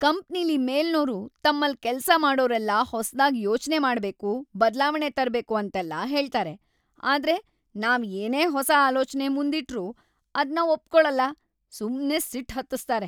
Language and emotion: Kannada, angry